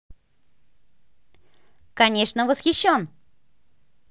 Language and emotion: Russian, positive